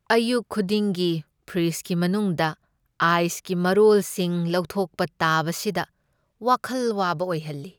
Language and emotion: Manipuri, sad